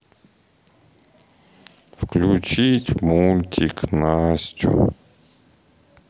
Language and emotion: Russian, sad